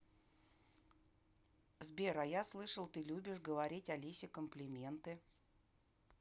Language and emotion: Russian, neutral